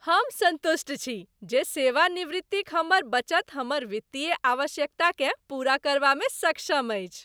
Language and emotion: Maithili, happy